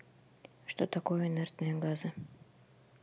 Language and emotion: Russian, neutral